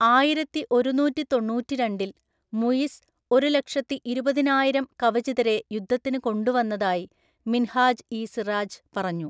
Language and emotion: Malayalam, neutral